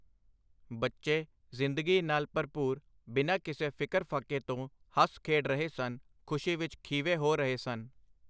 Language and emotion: Punjabi, neutral